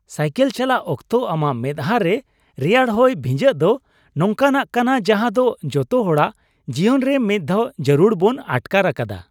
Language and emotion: Santali, happy